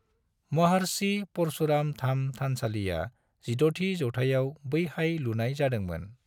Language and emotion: Bodo, neutral